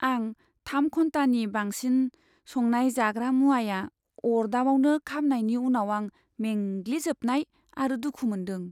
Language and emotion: Bodo, sad